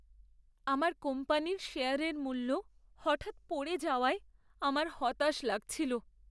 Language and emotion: Bengali, sad